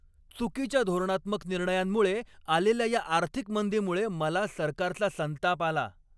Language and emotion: Marathi, angry